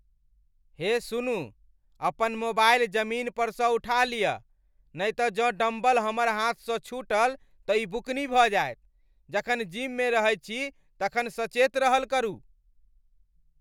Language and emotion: Maithili, angry